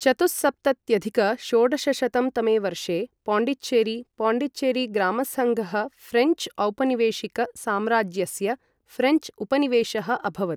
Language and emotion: Sanskrit, neutral